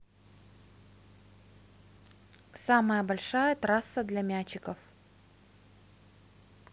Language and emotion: Russian, neutral